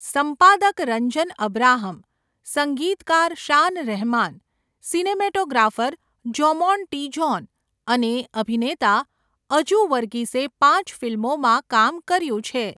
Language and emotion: Gujarati, neutral